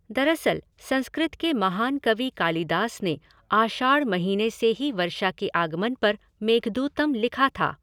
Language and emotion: Hindi, neutral